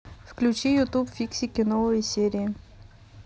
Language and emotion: Russian, neutral